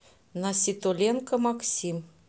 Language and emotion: Russian, neutral